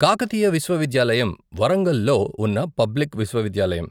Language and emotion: Telugu, neutral